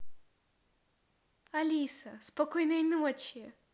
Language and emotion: Russian, positive